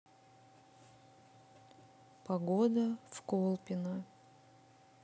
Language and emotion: Russian, sad